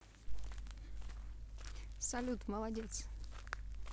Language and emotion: Russian, neutral